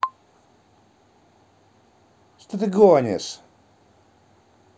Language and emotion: Russian, angry